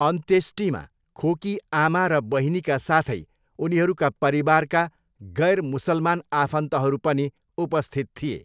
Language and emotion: Nepali, neutral